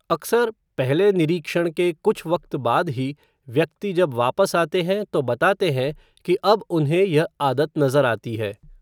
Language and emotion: Hindi, neutral